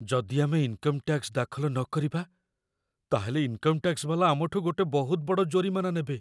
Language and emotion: Odia, fearful